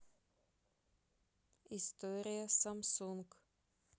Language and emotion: Russian, neutral